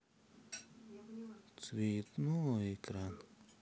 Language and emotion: Russian, sad